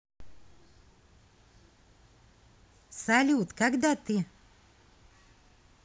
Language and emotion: Russian, positive